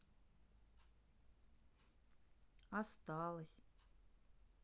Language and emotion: Russian, sad